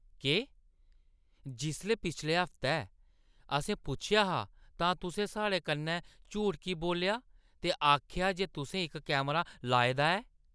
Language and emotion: Dogri, angry